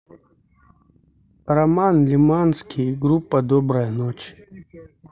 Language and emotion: Russian, neutral